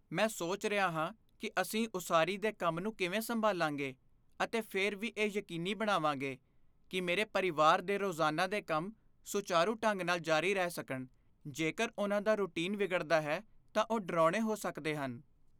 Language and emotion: Punjabi, fearful